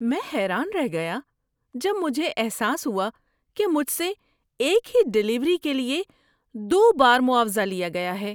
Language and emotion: Urdu, surprised